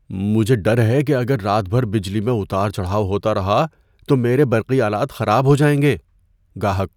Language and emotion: Urdu, fearful